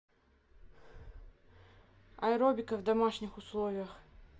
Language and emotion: Russian, neutral